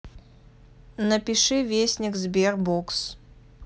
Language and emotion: Russian, neutral